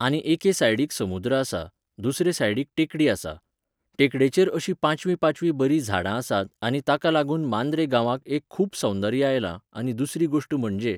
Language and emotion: Goan Konkani, neutral